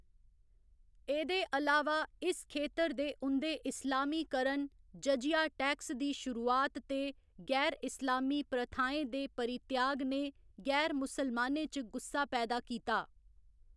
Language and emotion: Dogri, neutral